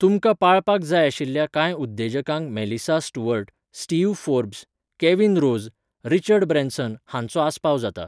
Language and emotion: Goan Konkani, neutral